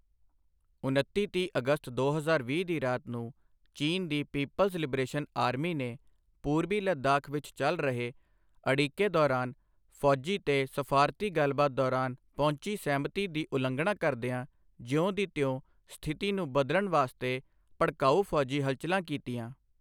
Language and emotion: Punjabi, neutral